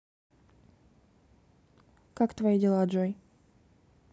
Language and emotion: Russian, neutral